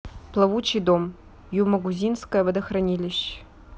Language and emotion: Russian, neutral